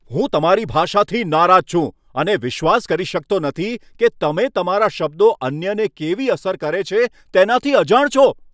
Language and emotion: Gujarati, angry